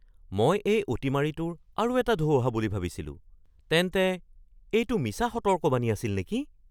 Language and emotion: Assamese, surprised